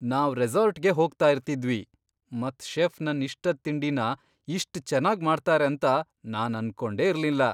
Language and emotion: Kannada, surprised